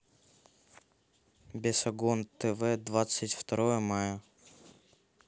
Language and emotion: Russian, neutral